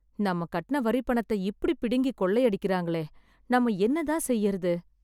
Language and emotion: Tamil, sad